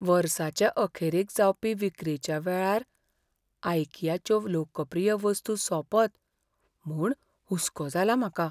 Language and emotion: Goan Konkani, fearful